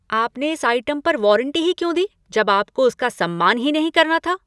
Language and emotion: Hindi, angry